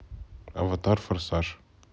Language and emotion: Russian, neutral